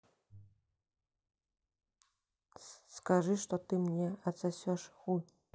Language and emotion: Russian, neutral